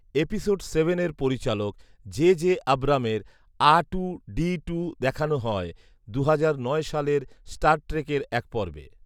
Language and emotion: Bengali, neutral